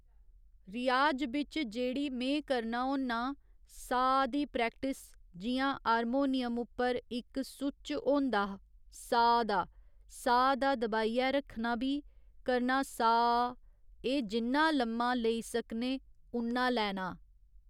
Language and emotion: Dogri, neutral